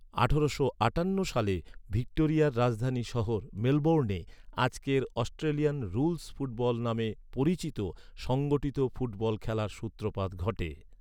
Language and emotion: Bengali, neutral